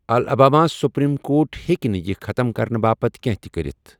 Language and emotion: Kashmiri, neutral